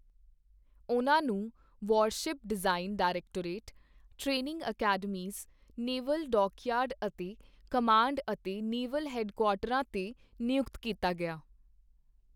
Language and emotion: Punjabi, neutral